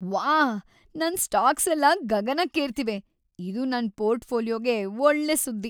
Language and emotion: Kannada, happy